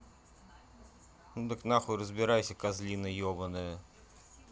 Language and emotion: Russian, angry